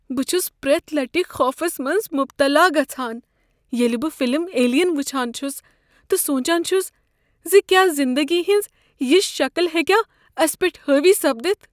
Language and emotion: Kashmiri, fearful